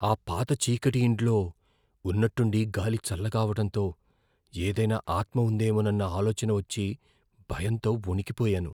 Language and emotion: Telugu, fearful